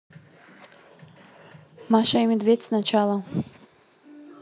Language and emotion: Russian, neutral